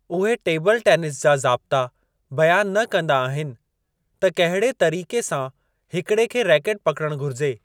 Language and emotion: Sindhi, neutral